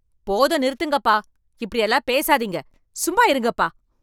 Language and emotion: Tamil, angry